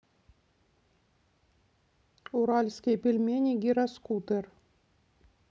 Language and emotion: Russian, neutral